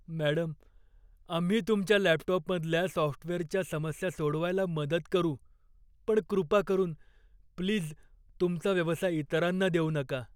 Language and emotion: Marathi, fearful